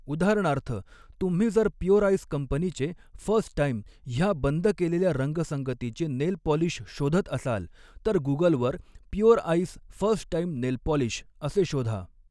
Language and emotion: Marathi, neutral